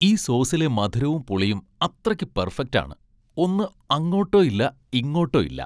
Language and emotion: Malayalam, happy